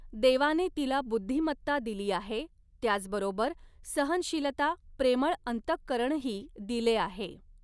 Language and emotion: Marathi, neutral